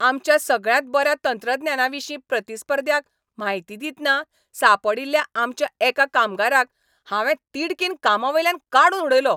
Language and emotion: Goan Konkani, angry